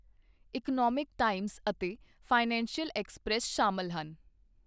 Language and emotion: Punjabi, neutral